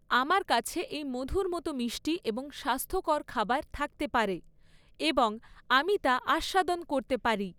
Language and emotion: Bengali, neutral